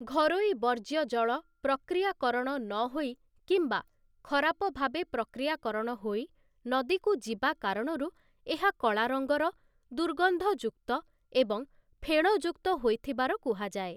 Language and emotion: Odia, neutral